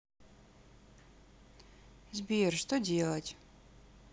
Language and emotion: Russian, sad